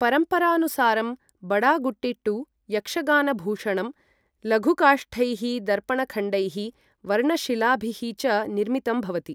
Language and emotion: Sanskrit, neutral